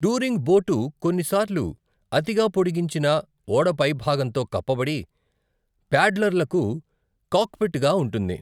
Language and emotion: Telugu, neutral